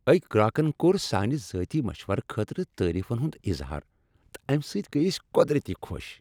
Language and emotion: Kashmiri, happy